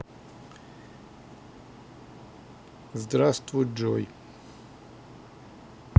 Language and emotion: Russian, neutral